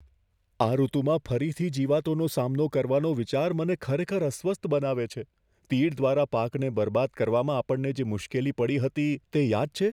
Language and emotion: Gujarati, fearful